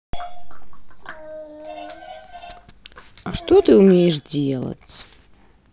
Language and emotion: Russian, neutral